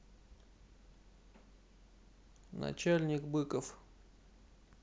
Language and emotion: Russian, neutral